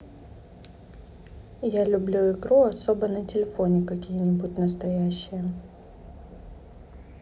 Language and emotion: Russian, neutral